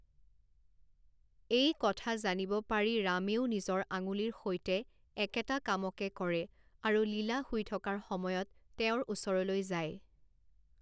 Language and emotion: Assamese, neutral